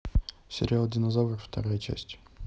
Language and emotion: Russian, neutral